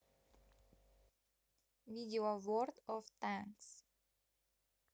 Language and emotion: Russian, neutral